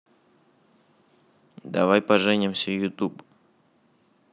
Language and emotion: Russian, neutral